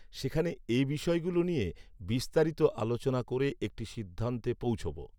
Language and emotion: Bengali, neutral